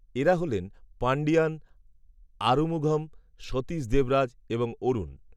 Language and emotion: Bengali, neutral